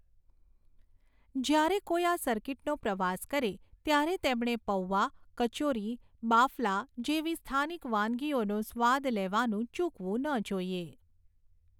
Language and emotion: Gujarati, neutral